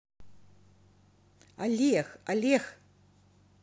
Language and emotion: Russian, positive